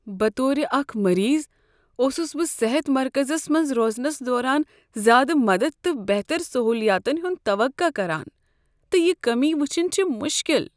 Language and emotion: Kashmiri, sad